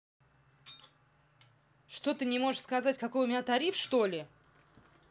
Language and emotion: Russian, angry